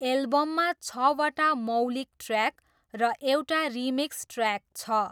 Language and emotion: Nepali, neutral